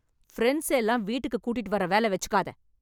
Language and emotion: Tamil, angry